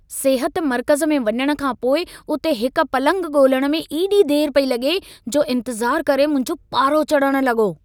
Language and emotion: Sindhi, angry